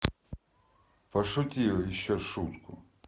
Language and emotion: Russian, neutral